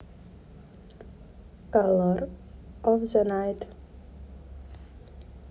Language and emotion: Russian, neutral